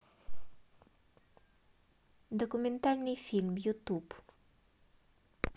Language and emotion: Russian, neutral